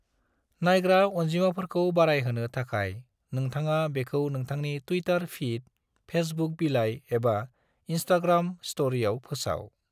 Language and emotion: Bodo, neutral